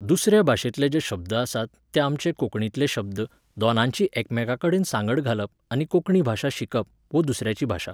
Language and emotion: Goan Konkani, neutral